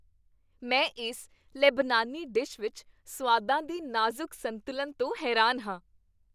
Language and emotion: Punjabi, happy